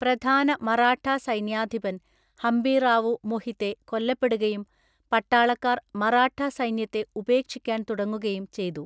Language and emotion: Malayalam, neutral